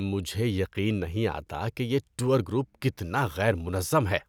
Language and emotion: Urdu, disgusted